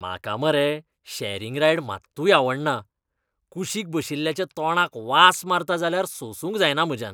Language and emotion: Goan Konkani, disgusted